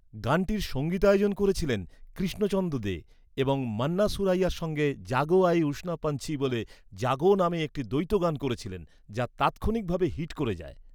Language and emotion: Bengali, neutral